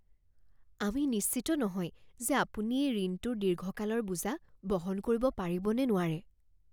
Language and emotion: Assamese, fearful